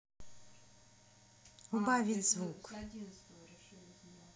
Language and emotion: Russian, neutral